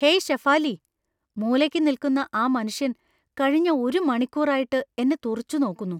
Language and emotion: Malayalam, fearful